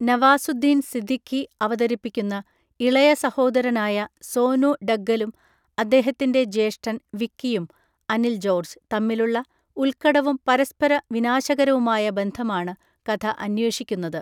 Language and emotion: Malayalam, neutral